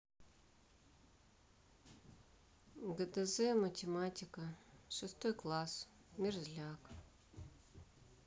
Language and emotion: Russian, neutral